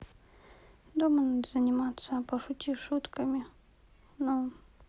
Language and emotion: Russian, sad